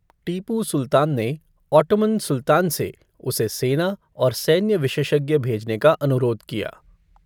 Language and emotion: Hindi, neutral